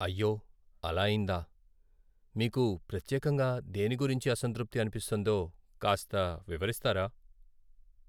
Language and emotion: Telugu, sad